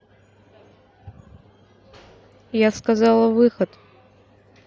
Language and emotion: Russian, neutral